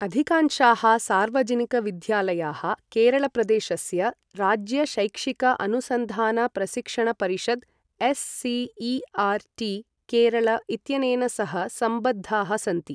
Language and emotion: Sanskrit, neutral